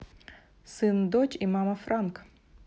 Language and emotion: Russian, neutral